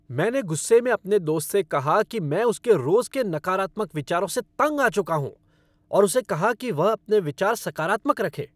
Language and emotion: Hindi, angry